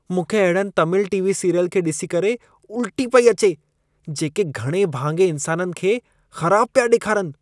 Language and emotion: Sindhi, disgusted